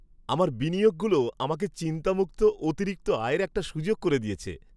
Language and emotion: Bengali, happy